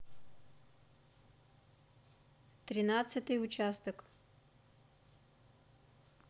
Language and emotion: Russian, neutral